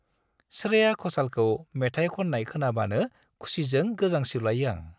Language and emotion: Bodo, happy